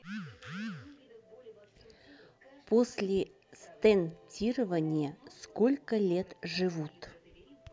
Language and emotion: Russian, neutral